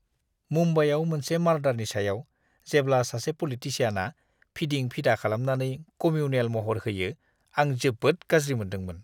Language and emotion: Bodo, disgusted